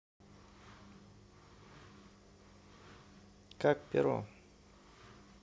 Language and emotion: Russian, neutral